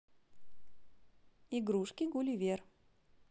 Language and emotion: Russian, positive